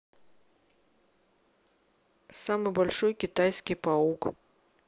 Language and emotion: Russian, neutral